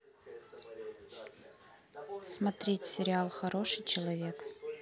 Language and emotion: Russian, neutral